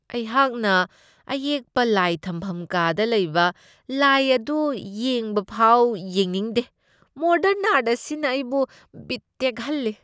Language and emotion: Manipuri, disgusted